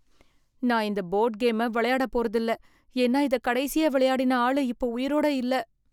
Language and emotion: Tamil, fearful